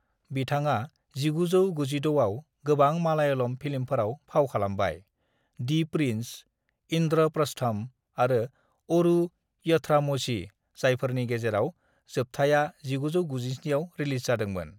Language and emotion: Bodo, neutral